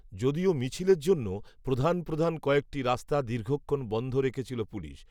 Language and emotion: Bengali, neutral